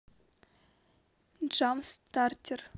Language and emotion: Russian, neutral